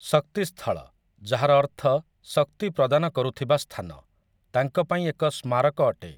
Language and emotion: Odia, neutral